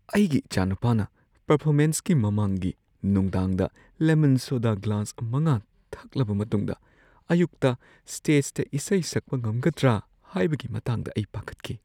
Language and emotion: Manipuri, fearful